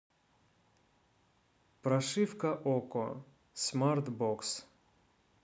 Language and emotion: Russian, neutral